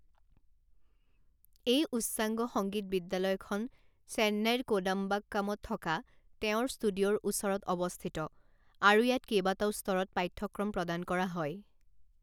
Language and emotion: Assamese, neutral